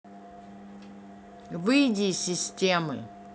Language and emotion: Russian, angry